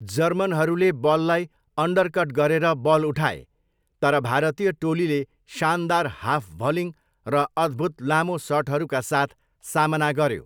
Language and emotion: Nepali, neutral